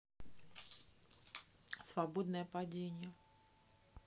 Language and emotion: Russian, neutral